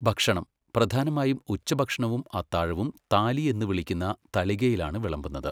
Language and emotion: Malayalam, neutral